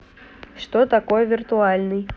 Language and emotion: Russian, neutral